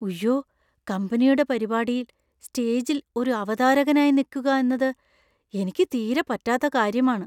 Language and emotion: Malayalam, fearful